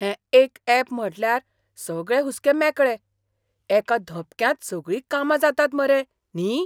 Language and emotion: Goan Konkani, surprised